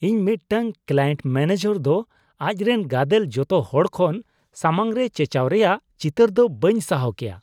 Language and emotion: Santali, disgusted